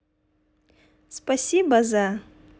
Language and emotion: Russian, positive